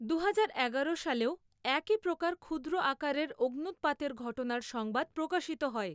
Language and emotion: Bengali, neutral